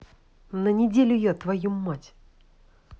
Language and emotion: Russian, angry